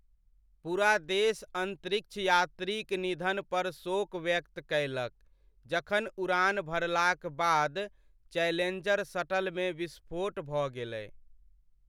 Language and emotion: Maithili, sad